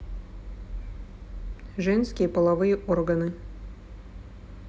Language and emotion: Russian, neutral